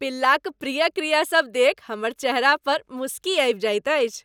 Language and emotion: Maithili, happy